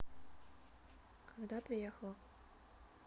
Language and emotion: Russian, neutral